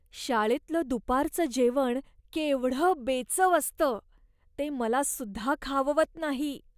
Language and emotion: Marathi, disgusted